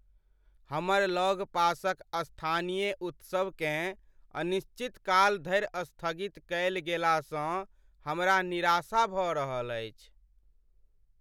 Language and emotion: Maithili, sad